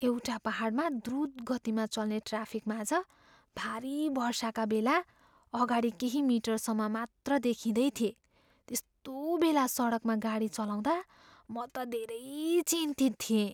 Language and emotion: Nepali, fearful